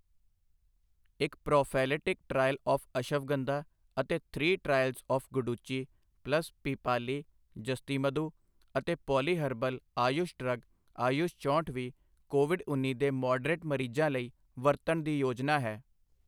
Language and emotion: Punjabi, neutral